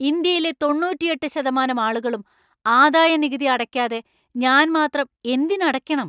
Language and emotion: Malayalam, angry